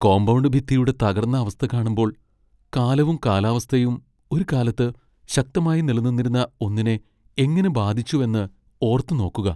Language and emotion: Malayalam, sad